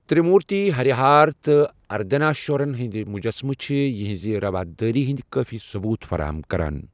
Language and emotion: Kashmiri, neutral